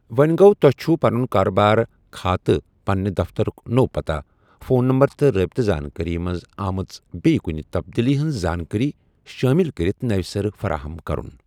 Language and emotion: Kashmiri, neutral